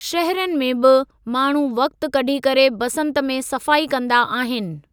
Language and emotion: Sindhi, neutral